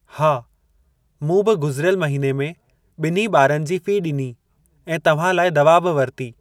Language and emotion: Sindhi, neutral